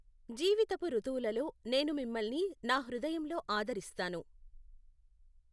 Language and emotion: Telugu, neutral